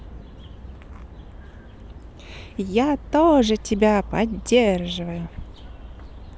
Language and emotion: Russian, positive